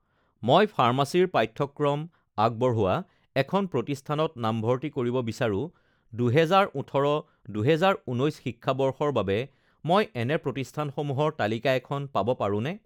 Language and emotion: Assamese, neutral